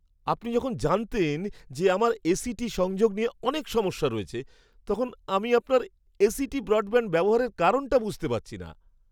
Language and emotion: Bengali, surprised